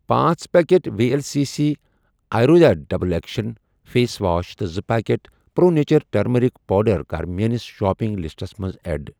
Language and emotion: Kashmiri, neutral